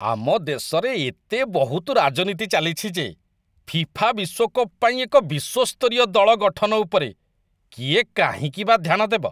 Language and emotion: Odia, disgusted